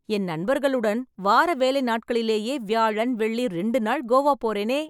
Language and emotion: Tamil, happy